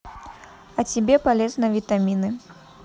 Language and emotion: Russian, neutral